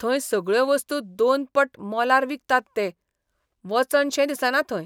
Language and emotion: Goan Konkani, disgusted